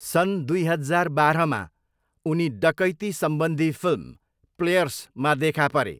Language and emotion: Nepali, neutral